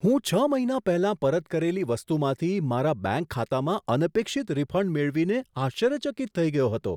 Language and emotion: Gujarati, surprised